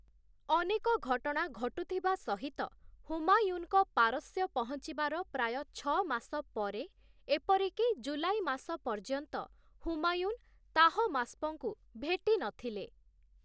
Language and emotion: Odia, neutral